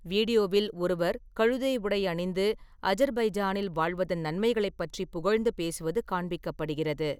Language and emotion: Tamil, neutral